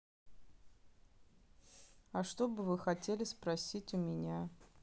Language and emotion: Russian, neutral